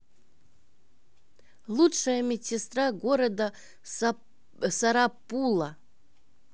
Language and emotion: Russian, neutral